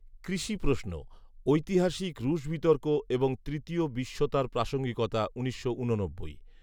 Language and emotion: Bengali, neutral